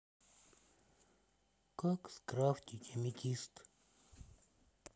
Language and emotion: Russian, sad